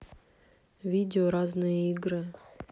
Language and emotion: Russian, neutral